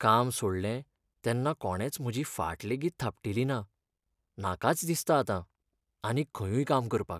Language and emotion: Goan Konkani, sad